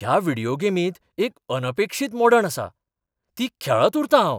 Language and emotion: Goan Konkani, surprised